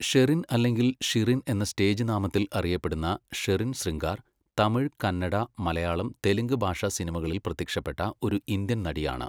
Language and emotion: Malayalam, neutral